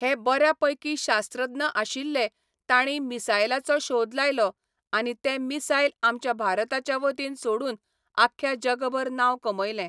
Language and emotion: Goan Konkani, neutral